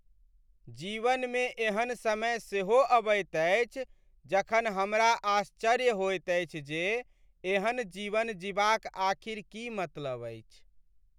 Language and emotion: Maithili, sad